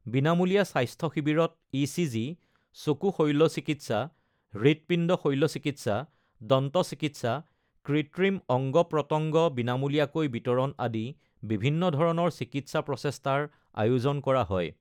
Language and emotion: Assamese, neutral